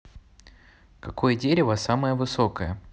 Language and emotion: Russian, neutral